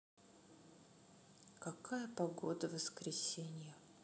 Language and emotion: Russian, sad